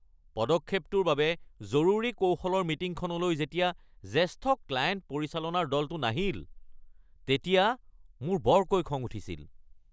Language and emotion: Assamese, angry